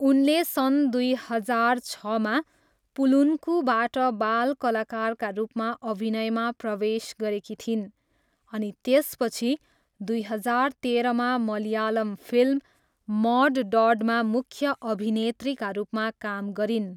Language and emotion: Nepali, neutral